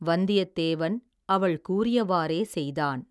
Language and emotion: Tamil, neutral